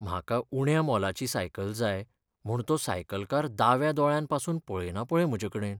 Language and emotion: Goan Konkani, sad